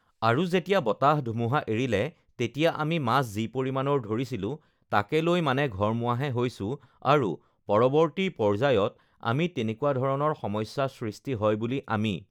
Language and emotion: Assamese, neutral